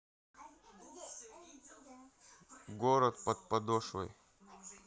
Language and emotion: Russian, neutral